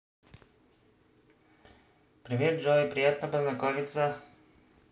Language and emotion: Russian, positive